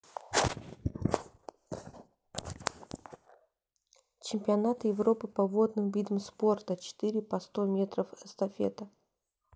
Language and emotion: Russian, neutral